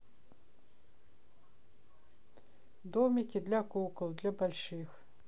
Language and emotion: Russian, neutral